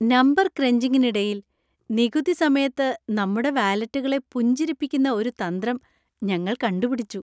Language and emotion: Malayalam, happy